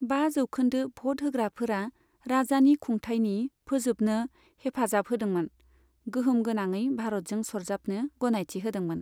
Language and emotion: Bodo, neutral